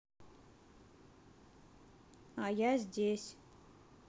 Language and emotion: Russian, neutral